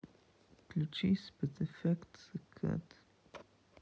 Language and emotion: Russian, sad